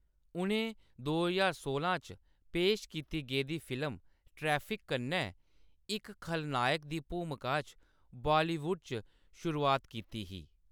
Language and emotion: Dogri, neutral